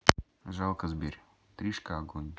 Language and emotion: Russian, neutral